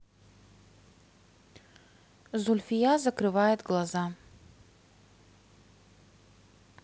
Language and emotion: Russian, neutral